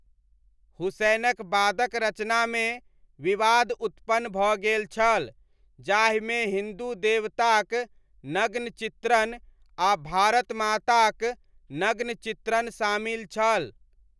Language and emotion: Maithili, neutral